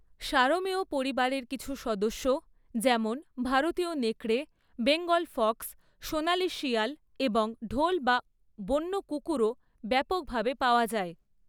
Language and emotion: Bengali, neutral